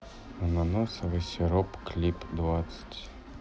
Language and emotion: Russian, sad